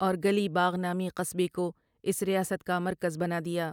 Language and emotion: Urdu, neutral